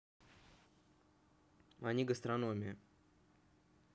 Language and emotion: Russian, neutral